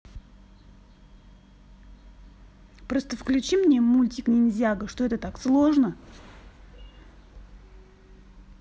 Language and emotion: Russian, angry